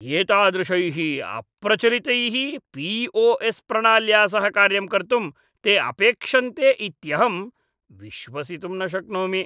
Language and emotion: Sanskrit, disgusted